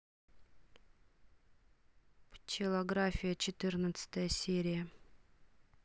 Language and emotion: Russian, neutral